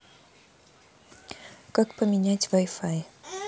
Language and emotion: Russian, neutral